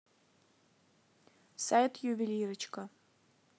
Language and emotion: Russian, neutral